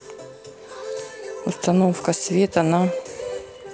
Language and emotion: Russian, neutral